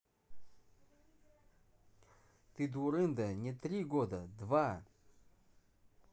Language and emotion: Russian, angry